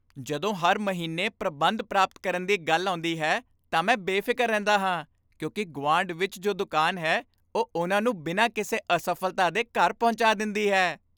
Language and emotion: Punjabi, happy